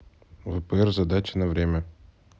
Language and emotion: Russian, neutral